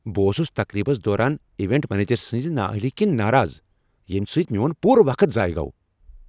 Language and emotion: Kashmiri, angry